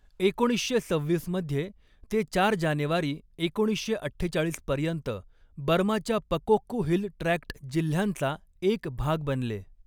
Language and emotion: Marathi, neutral